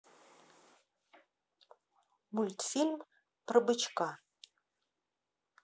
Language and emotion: Russian, neutral